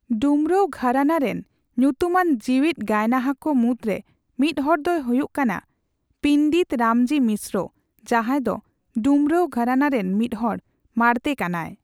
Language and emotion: Santali, neutral